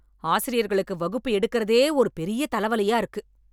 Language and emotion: Tamil, angry